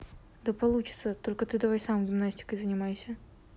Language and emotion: Russian, neutral